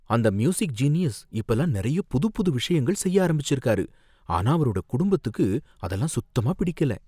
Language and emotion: Tamil, fearful